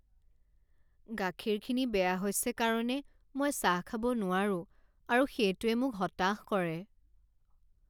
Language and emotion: Assamese, sad